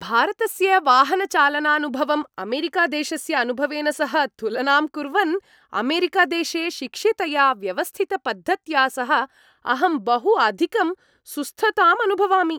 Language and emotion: Sanskrit, happy